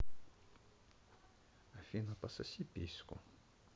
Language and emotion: Russian, neutral